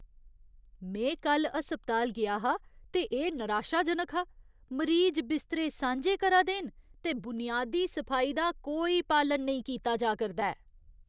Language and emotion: Dogri, disgusted